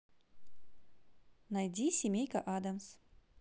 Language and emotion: Russian, positive